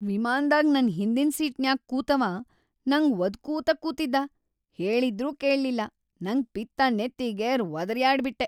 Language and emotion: Kannada, angry